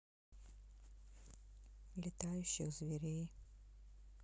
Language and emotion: Russian, neutral